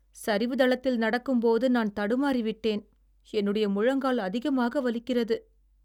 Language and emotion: Tamil, sad